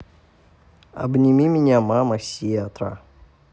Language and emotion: Russian, neutral